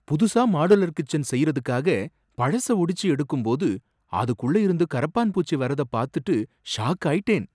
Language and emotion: Tamil, surprised